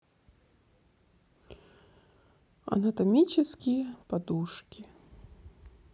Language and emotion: Russian, sad